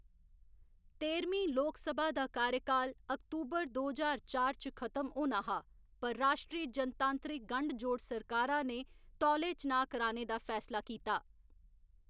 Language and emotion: Dogri, neutral